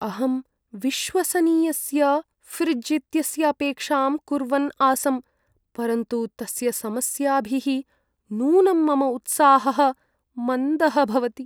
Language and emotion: Sanskrit, sad